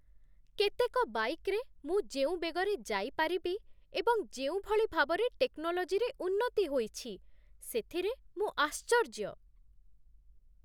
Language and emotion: Odia, surprised